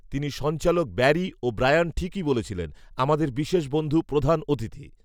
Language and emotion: Bengali, neutral